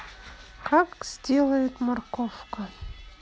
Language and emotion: Russian, neutral